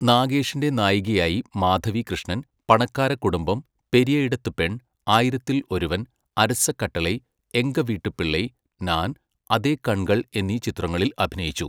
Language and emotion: Malayalam, neutral